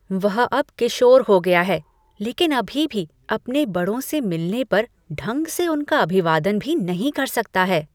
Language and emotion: Hindi, disgusted